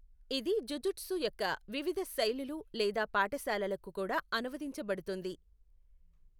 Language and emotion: Telugu, neutral